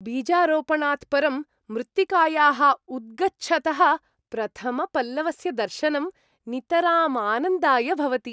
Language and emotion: Sanskrit, happy